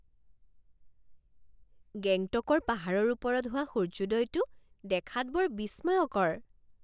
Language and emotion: Assamese, surprised